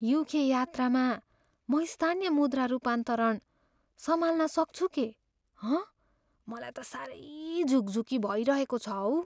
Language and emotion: Nepali, fearful